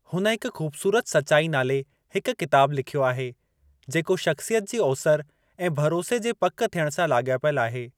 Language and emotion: Sindhi, neutral